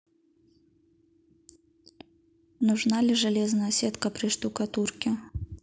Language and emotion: Russian, neutral